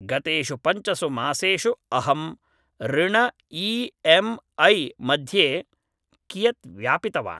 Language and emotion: Sanskrit, neutral